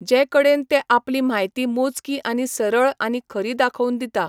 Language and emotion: Goan Konkani, neutral